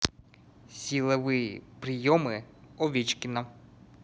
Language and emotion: Russian, neutral